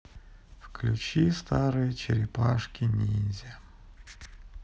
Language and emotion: Russian, sad